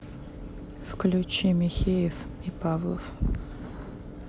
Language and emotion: Russian, sad